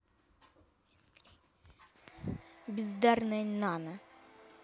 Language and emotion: Russian, angry